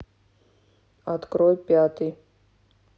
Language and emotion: Russian, neutral